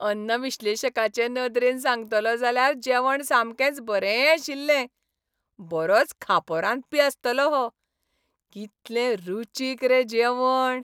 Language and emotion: Goan Konkani, happy